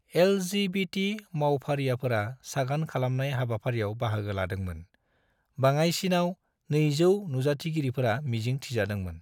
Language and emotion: Bodo, neutral